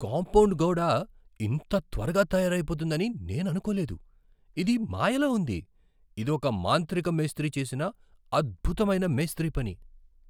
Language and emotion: Telugu, surprised